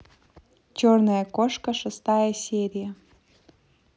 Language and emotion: Russian, neutral